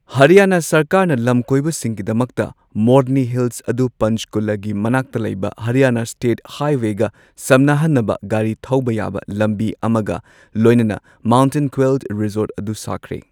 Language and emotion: Manipuri, neutral